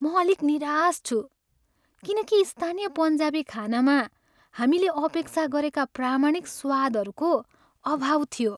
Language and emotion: Nepali, sad